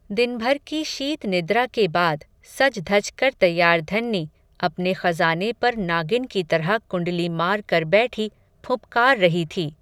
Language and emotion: Hindi, neutral